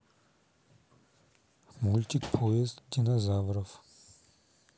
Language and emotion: Russian, neutral